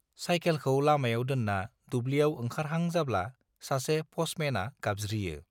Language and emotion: Bodo, neutral